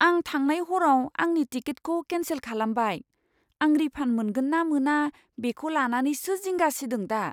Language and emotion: Bodo, fearful